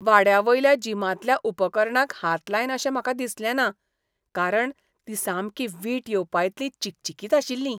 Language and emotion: Goan Konkani, disgusted